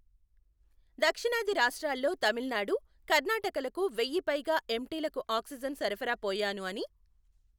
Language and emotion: Telugu, neutral